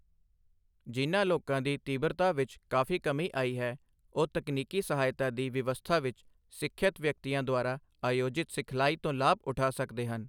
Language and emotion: Punjabi, neutral